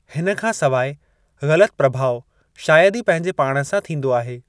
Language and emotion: Sindhi, neutral